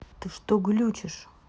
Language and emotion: Russian, angry